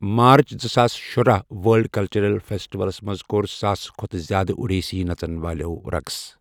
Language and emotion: Kashmiri, neutral